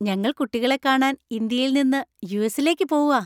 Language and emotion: Malayalam, happy